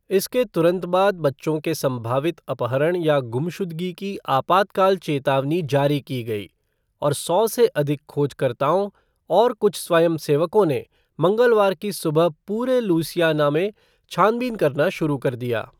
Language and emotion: Hindi, neutral